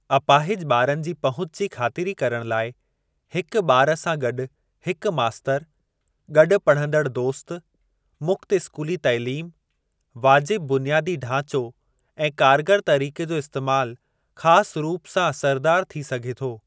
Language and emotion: Sindhi, neutral